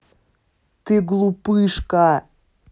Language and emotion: Russian, angry